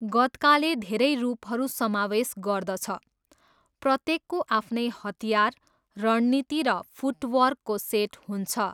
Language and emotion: Nepali, neutral